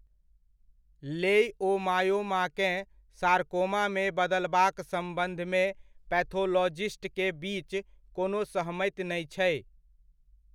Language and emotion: Maithili, neutral